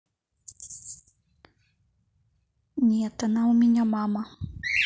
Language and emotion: Russian, neutral